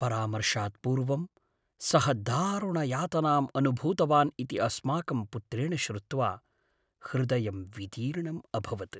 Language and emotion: Sanskrit, sad